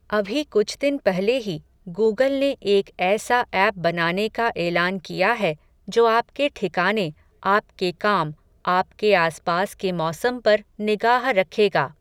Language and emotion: Hindi, neutral